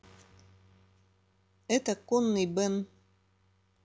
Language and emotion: Russian, neutral